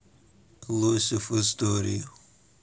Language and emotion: Russian, neutral